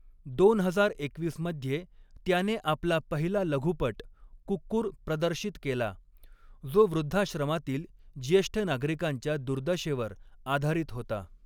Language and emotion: Marathi, neutral